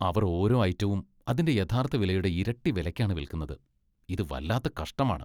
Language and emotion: Malayalam, disgusted